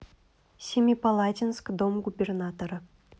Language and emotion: Russian, neutral